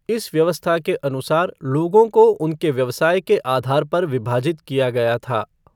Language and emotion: Hindi, neutral